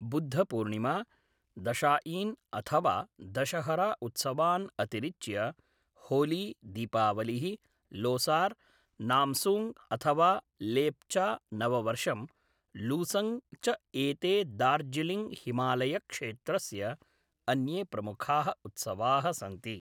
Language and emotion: Sanskrit, neutral